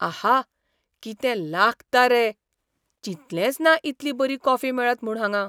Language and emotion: Goan Konkani, surprised